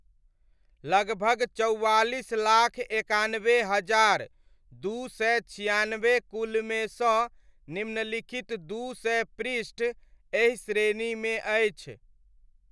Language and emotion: Maithili, neutral